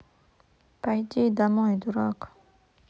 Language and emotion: Russian, neutral